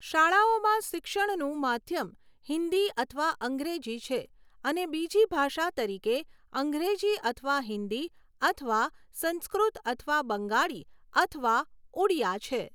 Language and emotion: Gujarati, neutral